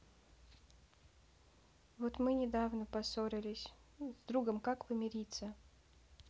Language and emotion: Russian, sad